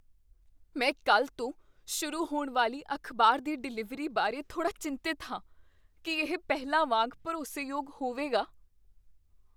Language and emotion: Punjabi, fearful